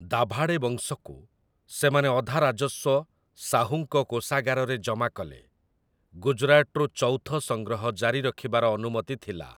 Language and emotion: Odia, neutral